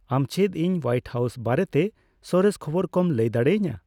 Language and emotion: Santali, neutral